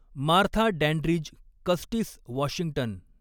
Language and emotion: Marathi, neutral